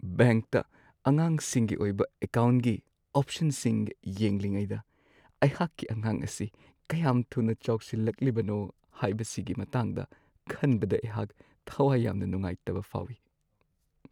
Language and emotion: Manipuri, sad